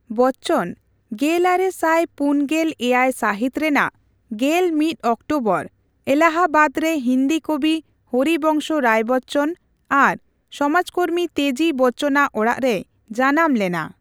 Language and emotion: Santali, neutral